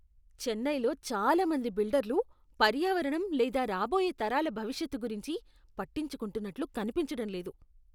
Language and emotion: Telugu, disgusted